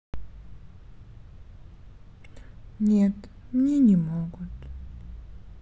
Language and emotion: Russian, sad